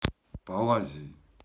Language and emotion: Russian, neutral